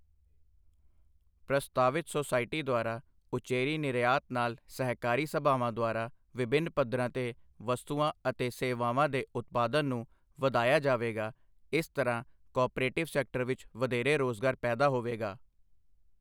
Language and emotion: Punjabi, neutral